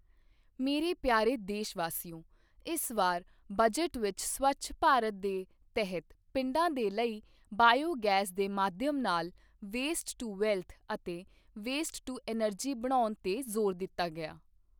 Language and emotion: Punjabi, neutral